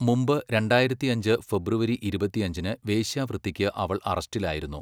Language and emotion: Malayalam, neutral